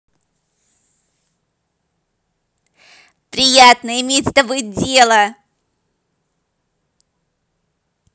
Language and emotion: Russian, positive